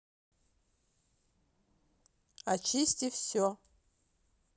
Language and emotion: Russian, neutral